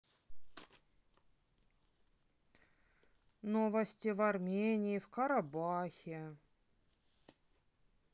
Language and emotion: Russian, neutral